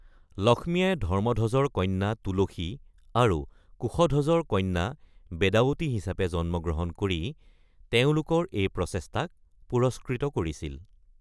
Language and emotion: Assamese, neutral